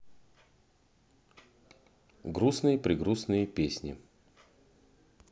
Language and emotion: Russian, neutral